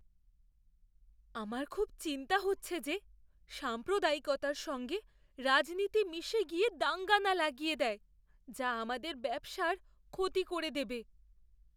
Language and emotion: Bengali, fearful